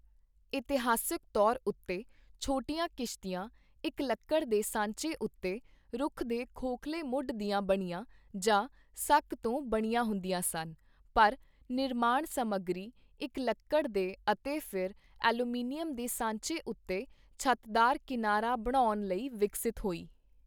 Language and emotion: Punjabi, neutral